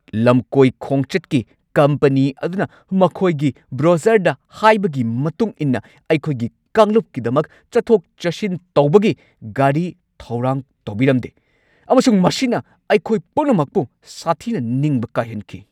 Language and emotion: Manipuri, angry